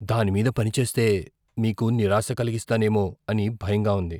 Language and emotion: Telugu, fearful